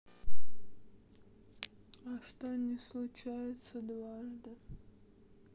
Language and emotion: Russian, sad